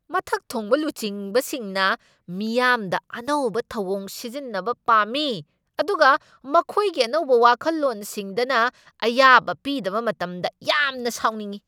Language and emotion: Manipuri, angry